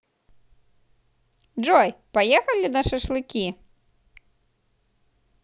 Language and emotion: Russian, positive